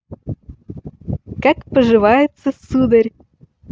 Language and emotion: Russian, positive